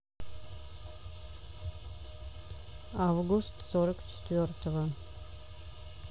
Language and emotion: Russian, neutral